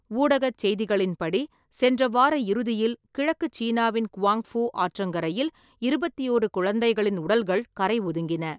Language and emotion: Tamil, neutral